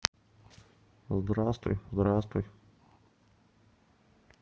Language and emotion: Russian, neutral